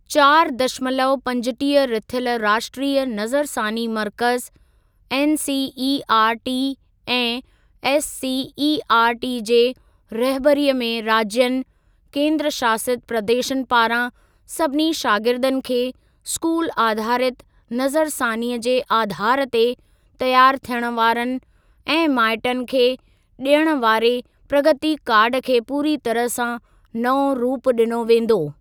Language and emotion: Sindhi, neutral